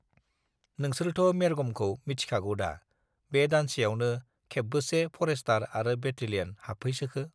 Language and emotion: Bodo, neutral